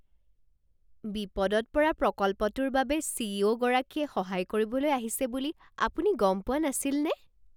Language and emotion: Assamese, surprised